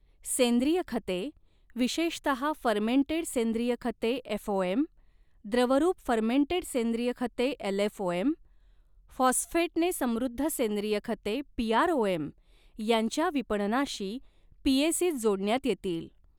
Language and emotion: Marathi, neutral